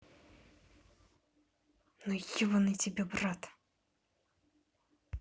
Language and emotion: Russian, angry